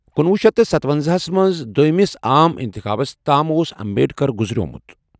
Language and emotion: Kashmiri, neutral